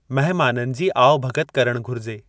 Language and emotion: Sindhi, neutral